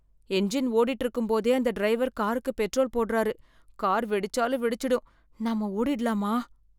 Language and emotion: Tamil, fearful